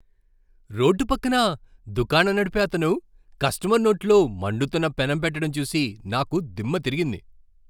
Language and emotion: Telugu, surprised